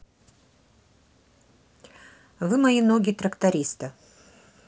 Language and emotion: Russian, neutral